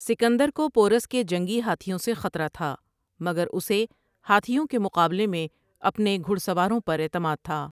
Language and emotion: Urdu, neutral